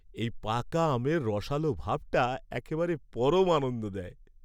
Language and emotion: Bengali, happy